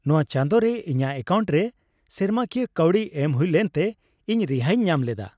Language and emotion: Santali, happy